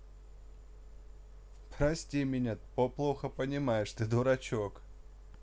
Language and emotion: Russian, neutral